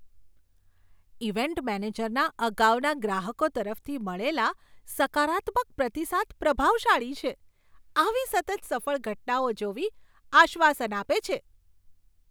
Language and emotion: Gujarati, surprised